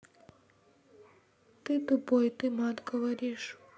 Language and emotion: Russian, sad